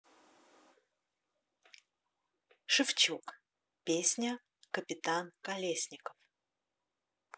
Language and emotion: Russian, neutral